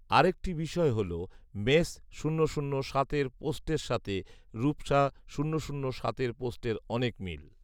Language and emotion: Bengali, neutral